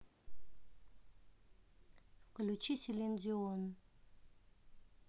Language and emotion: Russian, neutral